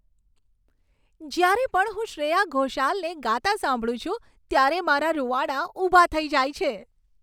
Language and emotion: Gujarati, happy